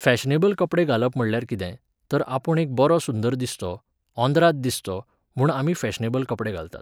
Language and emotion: Goan Konkani, neutral